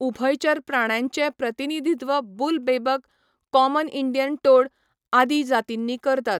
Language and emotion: Goan Konkani, neutral